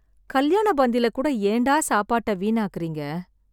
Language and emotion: Tamil, sad